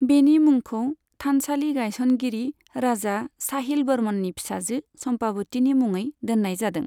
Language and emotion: Bodo, neutral